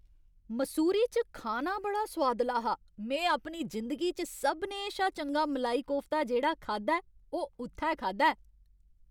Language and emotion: Dogri, happy